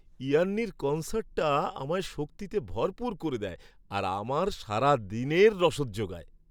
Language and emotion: Bengali, happy